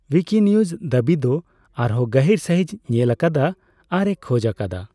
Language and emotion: Santali, neutral